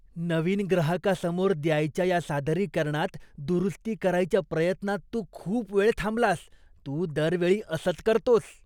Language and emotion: Marathi, disgusted